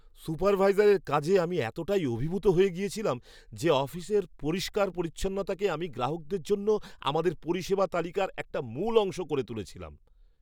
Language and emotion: Bengali, surprised